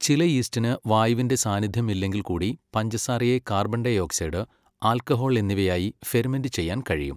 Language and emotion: Malayalam, neutral